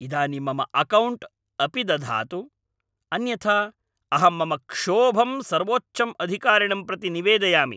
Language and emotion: Sanskrit, angry